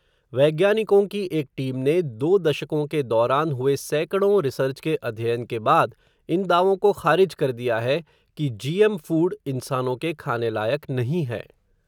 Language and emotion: Hindi, neutral